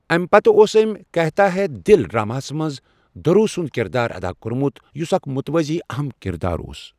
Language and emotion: Kashmiri, neutral